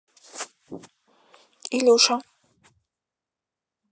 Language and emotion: Russian, neutral